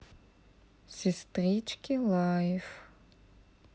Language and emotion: Russian, neutral